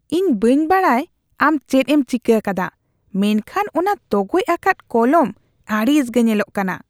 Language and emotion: Santali, disgusted